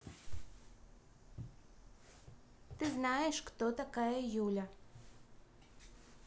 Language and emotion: Russian, positive